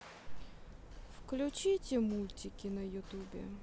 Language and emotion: Russian, sad